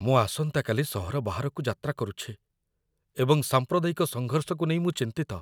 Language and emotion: Odia, fearful